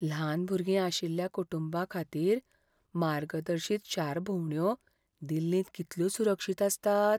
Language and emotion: Goan Konkani, fearful